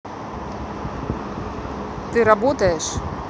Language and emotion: Russian, neutral